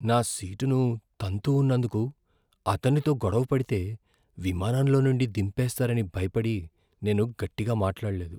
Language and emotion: Telugu, fearful